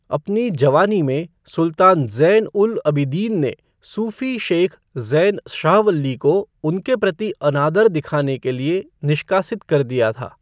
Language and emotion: Hindi, neutral